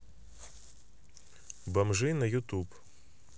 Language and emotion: Russian, neutral